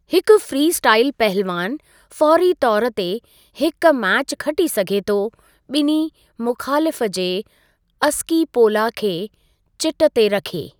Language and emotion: Sindhi, neutral